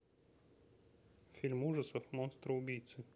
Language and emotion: Russian, neutral